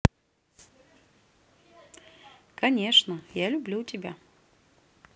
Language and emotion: Russian, neutral